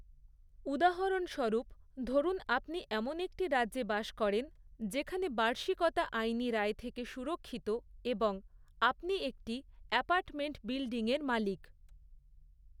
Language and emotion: Bengali, neutral